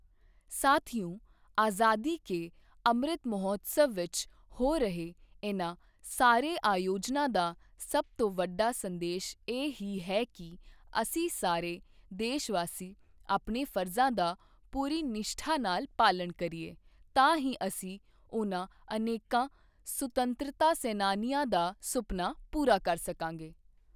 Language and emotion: Punjabi, neutral